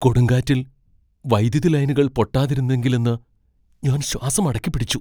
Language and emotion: Malayalam, fearful